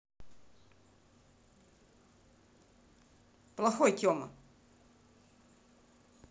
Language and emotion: Russian, angry